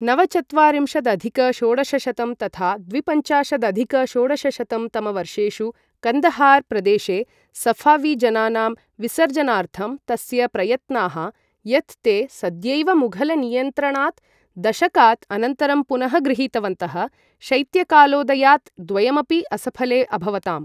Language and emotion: Sanskrit, neutral